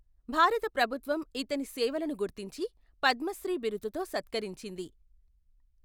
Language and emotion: Telugu, neutral